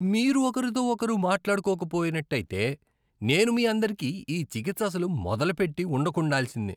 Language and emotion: Telugu, disgusted